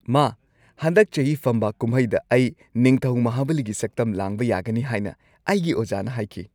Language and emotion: Manipuri, happy